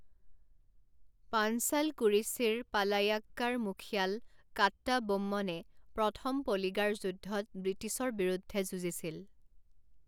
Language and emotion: Assamese, neutral